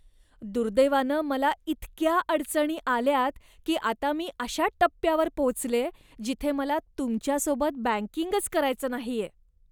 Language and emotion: Marathi, disgusted